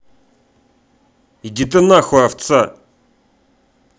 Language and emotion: Russian, angry